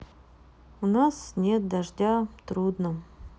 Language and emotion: Russian, sad